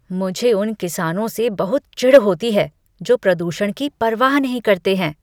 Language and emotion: Hindi, disgusted